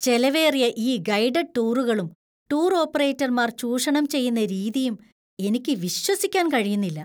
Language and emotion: Malayalam, disgusted